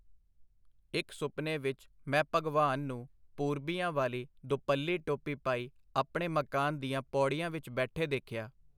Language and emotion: Punjabi, neutral